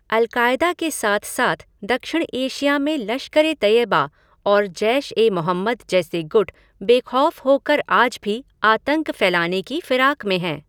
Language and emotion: Hindi, neutral